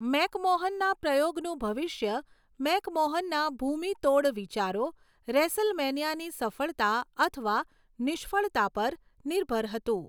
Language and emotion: Gujarati, neutral